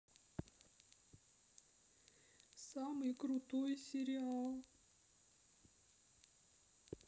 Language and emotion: Russian, sad